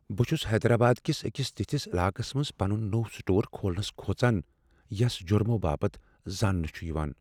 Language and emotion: Kashmiri, fearful